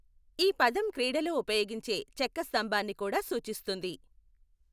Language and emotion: Telugu, neutral